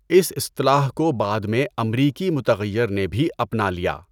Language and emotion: Urdu, neutral